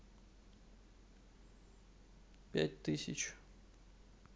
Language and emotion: Russian, neutral